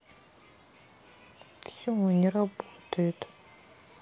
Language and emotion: Russian, sad